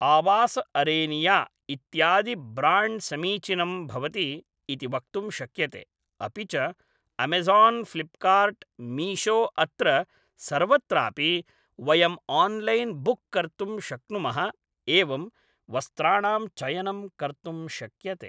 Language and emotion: Sanskrit, neutral